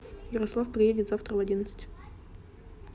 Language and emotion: Russian, neutral